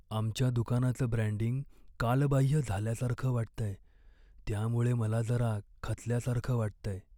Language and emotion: Marathi, sad